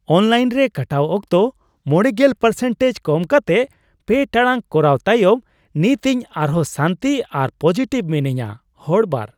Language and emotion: Santali, happy